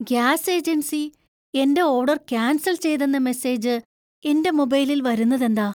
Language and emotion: Malayalam, surprised